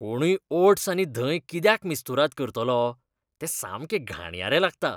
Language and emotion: Goan Konkani, disgusted